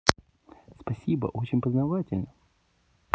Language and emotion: Russian, positive